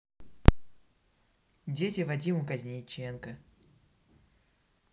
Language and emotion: Russian, neutral